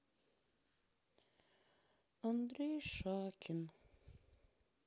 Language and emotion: Russian, sad